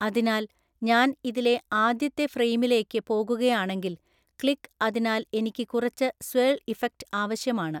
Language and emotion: Malayalam, neutral